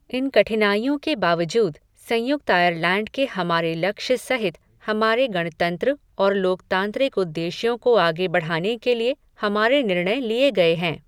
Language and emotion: Hindi, neutral